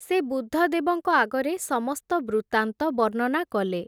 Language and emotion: Odia, neutral